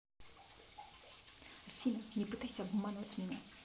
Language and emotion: Russian, angry